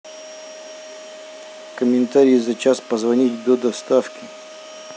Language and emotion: Russian, neutral